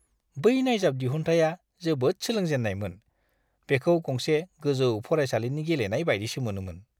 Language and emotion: Bodo, disgusted